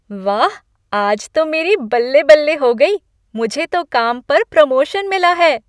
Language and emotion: Hindi, happy